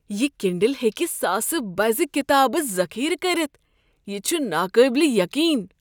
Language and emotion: Kashmiri, surprised